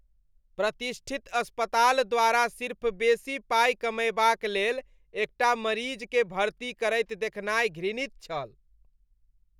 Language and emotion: Maithili, disgusted